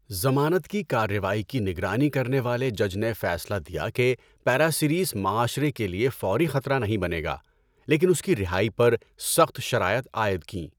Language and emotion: Urdu, neutral